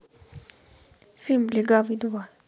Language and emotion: Russian, neutral